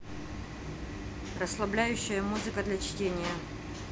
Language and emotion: Russian, neutral